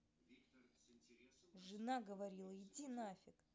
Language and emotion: Russian, angry